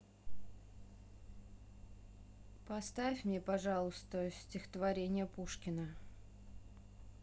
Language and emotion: Russian, neutral